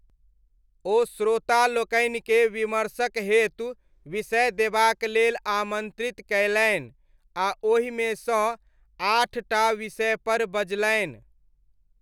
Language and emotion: Maithili, neutral